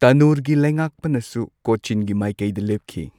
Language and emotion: Manipuri, neutral